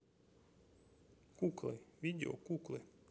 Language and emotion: Russian, neutral